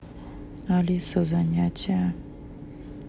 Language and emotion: Russian, neutral